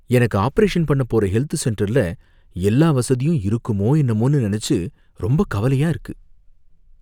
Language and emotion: Tamil, fearful